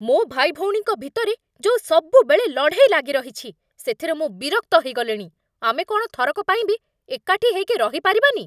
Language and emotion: Odia, angry